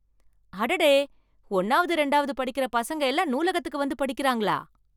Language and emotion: Tamil, surprised